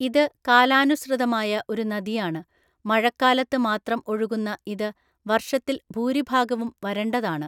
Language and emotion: Malayalam, neutral